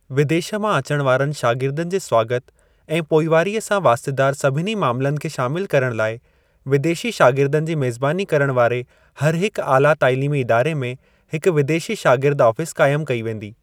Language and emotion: Sindhi, neutral